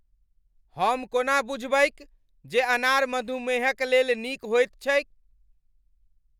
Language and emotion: Maithili, angry